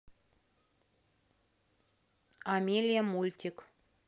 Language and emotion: Russian, neutral